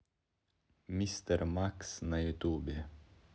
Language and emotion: Russian, neutral